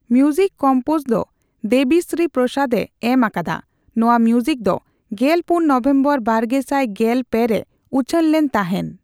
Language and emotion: Santali, neutral